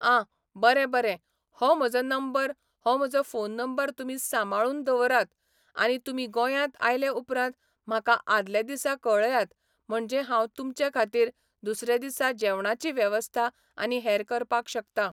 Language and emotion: Goan Konkani, neutral